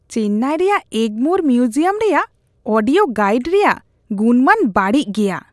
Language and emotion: Santali, disgusted